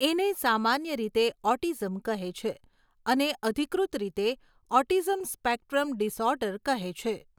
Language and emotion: Gujarati, neutral